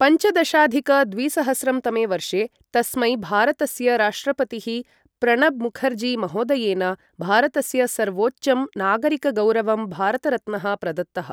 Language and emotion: Sanskrit, neutral